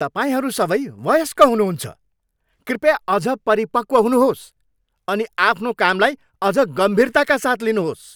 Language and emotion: Nepali, angry